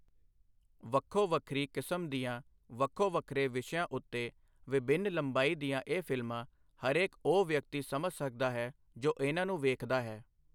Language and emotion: Punjabi, neutral